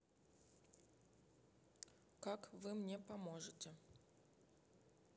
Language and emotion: Russian, neutral